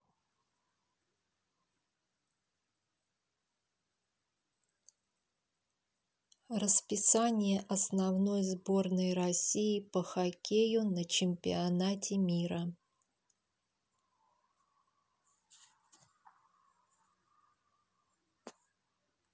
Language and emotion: Russian, neutral